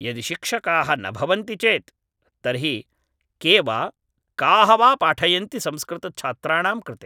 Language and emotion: Sanskrit, neutral